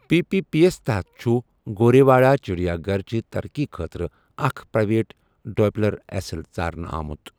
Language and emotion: Kashmiri, neutral